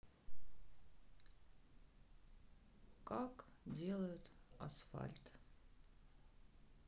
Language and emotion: Russian, sad